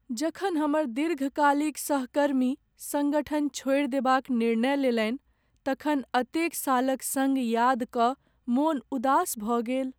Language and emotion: Maithili, sad